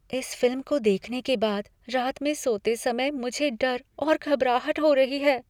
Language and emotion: Hindi, fearful